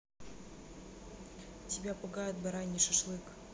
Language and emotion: Russian, neutral